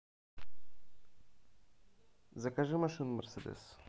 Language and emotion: Russian, neutral